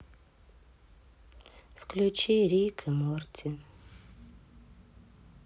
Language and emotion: Russian, sad